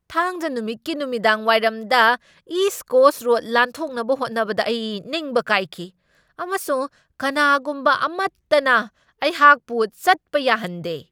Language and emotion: Manipuri, angry